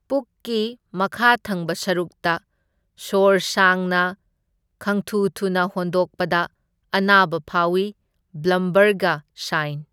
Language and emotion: Manipuri, neutral